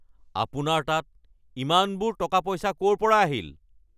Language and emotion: Assamese, angry